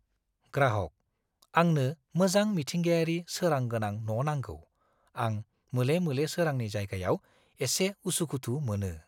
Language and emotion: Bodo, fearful